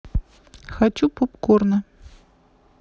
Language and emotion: Russian, neutral